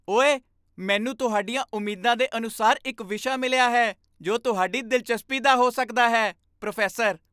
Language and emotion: Punjabi, happy